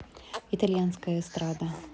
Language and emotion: Russian, neutral